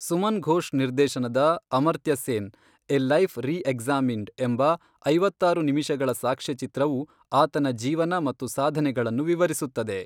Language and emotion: Kannada, neutral